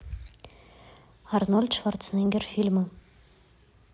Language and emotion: Russian, neutral